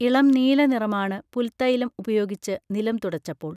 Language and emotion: Malayalam, neutral